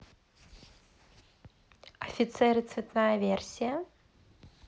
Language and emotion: Russian, neutral